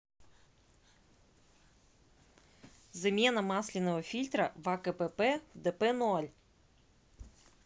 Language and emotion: Russian, neutral